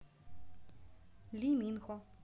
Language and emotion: Russian, neutral